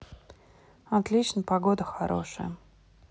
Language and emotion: Russian, neutral